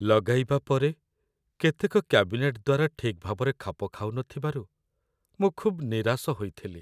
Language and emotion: Odia, sad